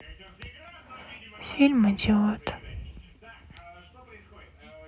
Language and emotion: Russian, sad